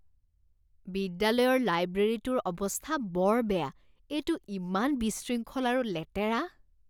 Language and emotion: Assamese, disgusted